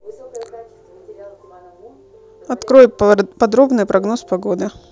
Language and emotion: Russian, neutral